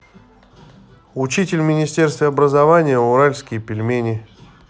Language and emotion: Russian, neutral